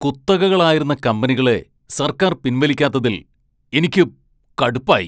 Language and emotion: Malayalam, angry